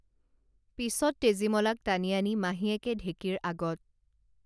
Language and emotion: Assamese, neutral